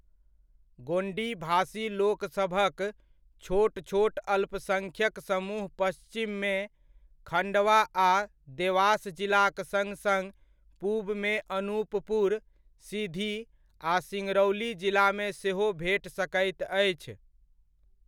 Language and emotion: Maithili, neutral